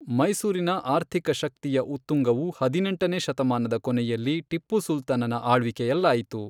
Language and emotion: Kannada, neutral